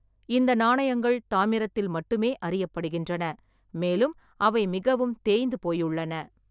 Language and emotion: Tamil, neutral